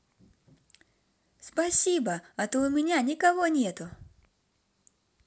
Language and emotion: Russian, positive